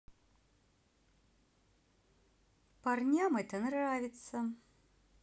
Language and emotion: Russian, neutral